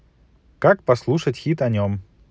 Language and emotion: Russian, positive